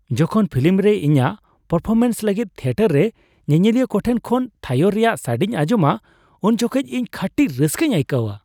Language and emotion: Santali, happy